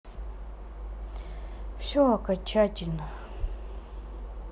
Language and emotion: Russian, sad